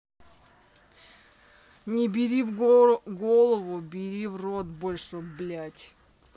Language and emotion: Russian, neutral